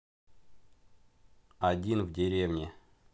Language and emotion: Russian, neutral